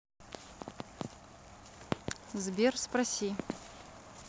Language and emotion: Russian, neutral